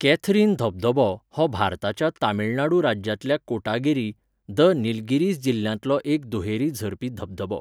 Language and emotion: Goan Konkani, neutral